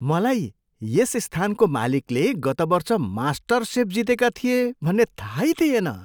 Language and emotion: Nepali, surprised